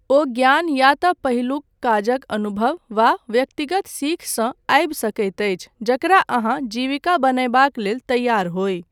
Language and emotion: Maithili, neutral